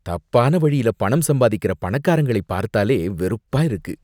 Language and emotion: Tamil, disgusted